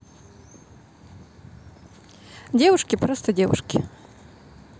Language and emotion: Russian, neutral